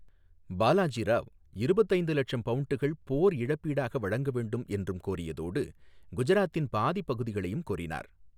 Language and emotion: Tamil, neutral